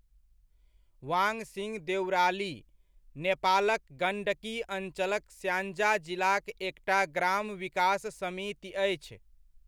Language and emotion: Maithili, neutral